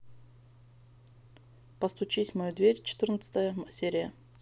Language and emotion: Russian, neutral